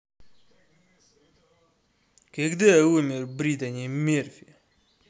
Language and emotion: Russian, angry